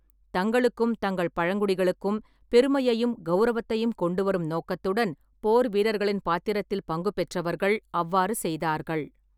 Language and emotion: Tamil, neutral